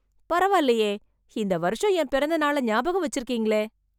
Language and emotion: Tamil, surprised